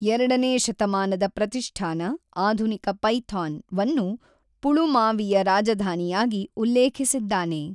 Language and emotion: Kannada, neutral